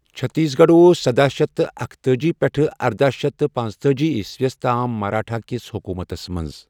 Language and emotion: Kashmiri, neutral